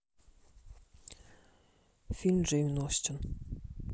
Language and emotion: Russian, neutral